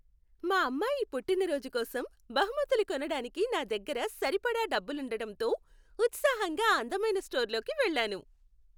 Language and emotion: Telugu, happy